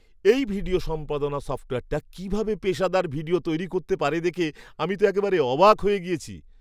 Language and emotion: Bengali, surprised